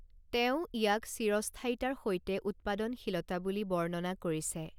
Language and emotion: Assamese, neutral